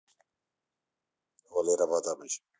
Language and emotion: Russian, neutral